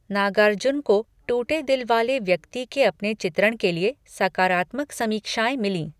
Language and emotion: Hindi, neutral